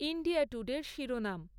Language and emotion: Bengali, neutral